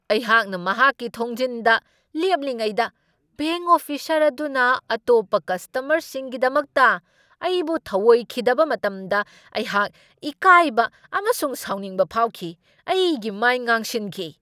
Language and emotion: Manipuri, angry